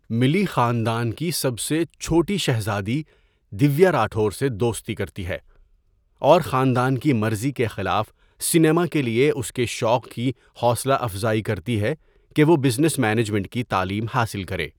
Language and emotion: Urdu, neutral